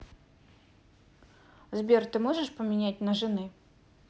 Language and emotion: Russian, neutral